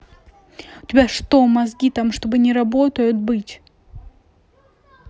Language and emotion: Russian, angry